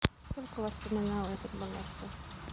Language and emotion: Russian, sad